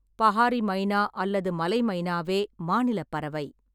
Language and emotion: Tamil, neutral